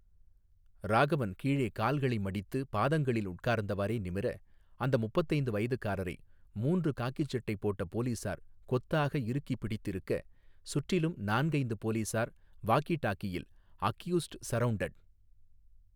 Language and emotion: Tamil, neutral